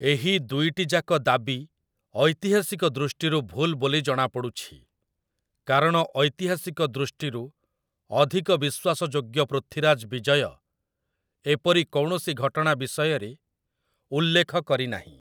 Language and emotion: Odia, neutral